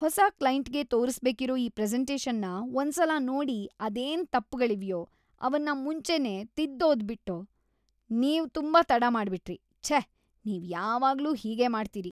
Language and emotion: Kannada, disgusted